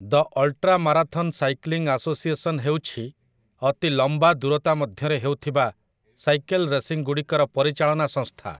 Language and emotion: Odia, neutral